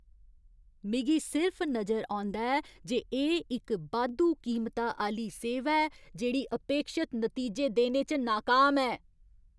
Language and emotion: Dogri, angry